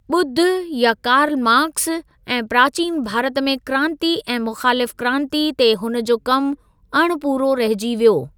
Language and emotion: Sindhi, neutral